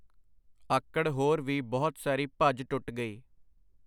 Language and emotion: Punjabi, neutral